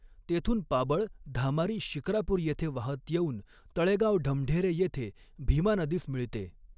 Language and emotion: Marathi, neutral